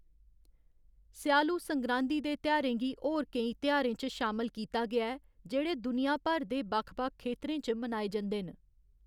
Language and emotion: Dogri, neutral